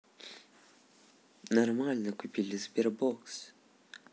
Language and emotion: Russian, neutral